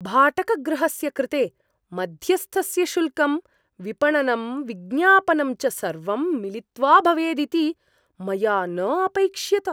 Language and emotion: Sanskrit, surprised